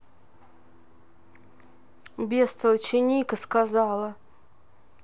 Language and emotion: Russian, neutral